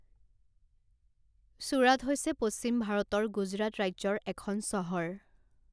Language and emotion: Assamese, neutral